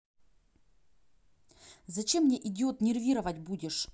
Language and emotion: Russian, angry